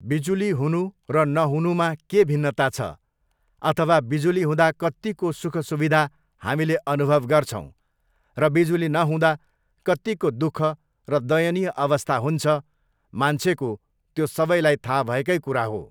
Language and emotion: Nepali, neutral